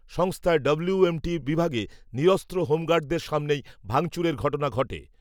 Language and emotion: Bengali, neutral